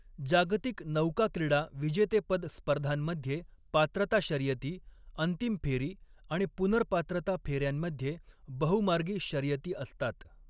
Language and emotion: Marathi, neutral